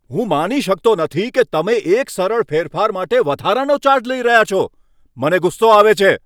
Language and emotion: Gujarati, angry